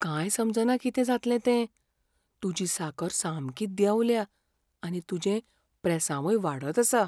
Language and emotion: Goan Konkani, fearful